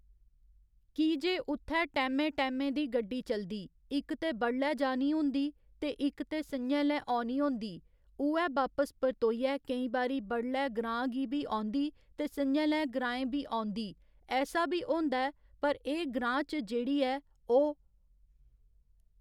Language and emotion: Dogri, neutral